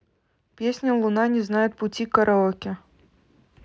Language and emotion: Russian, neutral